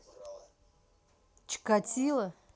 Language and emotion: Russian, neutral